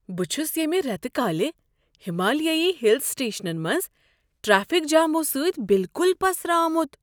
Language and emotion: Kashmiri, surprised